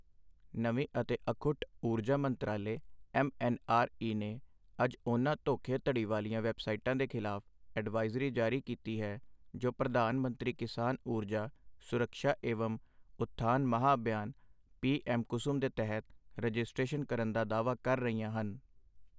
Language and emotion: Punjabi, neutral